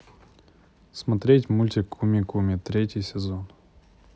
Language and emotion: Russian, neutral